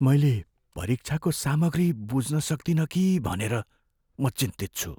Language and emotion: Nepali, fearful